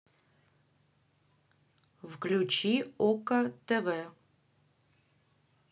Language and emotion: Russian, neutral